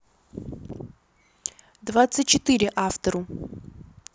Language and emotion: Russian, neutral